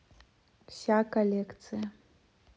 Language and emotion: Russian, neutral